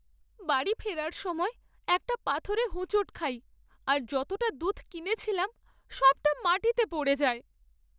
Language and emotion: Bengali, sad